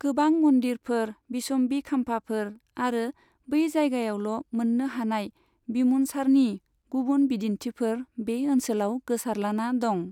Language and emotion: Bodo, neutral